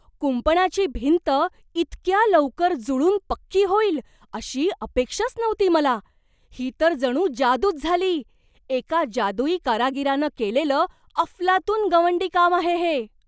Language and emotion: Marathi, surprised